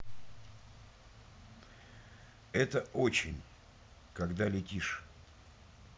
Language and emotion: Russian, neutral